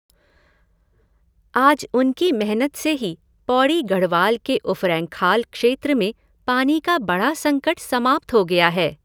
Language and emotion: Hindi, neutral